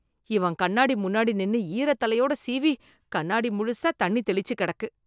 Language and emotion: Tamil, disgusted